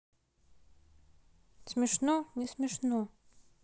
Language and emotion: Russian, neutral